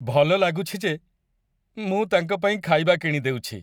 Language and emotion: Odia, happy